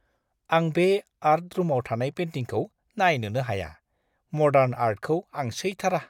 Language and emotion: Bodo, disgusted